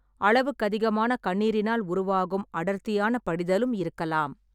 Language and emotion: Tamil, neutral